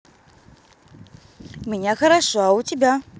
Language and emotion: Russian, positive